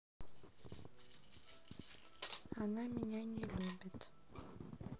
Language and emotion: Russian, sad